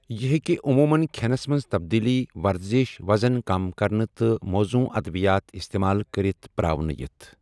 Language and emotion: Kashmiri, neutral